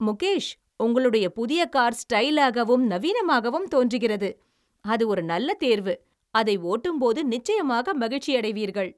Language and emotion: Tamil, happy